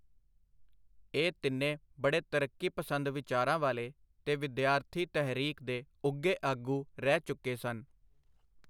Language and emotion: Punjabi, neutral